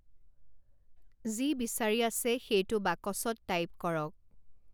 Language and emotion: Assamese, neutral